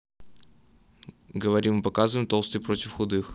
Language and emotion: Russian, neutral